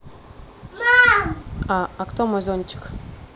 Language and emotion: Russian, neutral